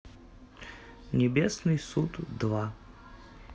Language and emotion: Russian, neutral